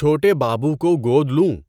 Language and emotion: Urdu, neutral